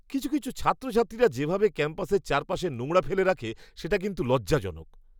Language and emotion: Bengali, disgusted